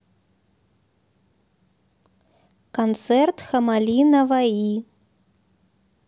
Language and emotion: Russian, neutral